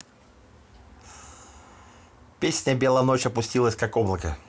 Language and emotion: Russian, neutral